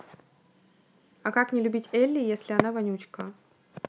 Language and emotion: Russian, neutral